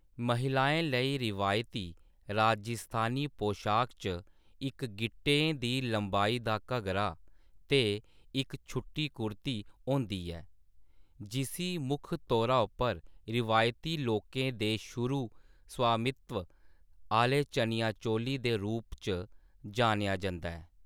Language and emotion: Dogri, neutral